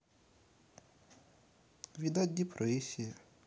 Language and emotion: Russian, sad